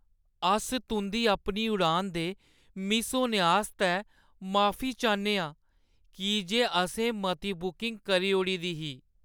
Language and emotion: Dogri, sad